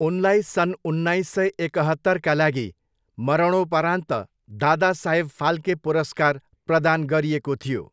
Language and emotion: Nepali, neutral